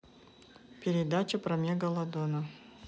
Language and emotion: Russian, neutral